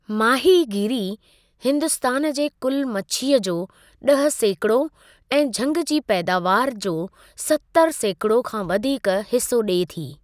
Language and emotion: Sindhi, neutral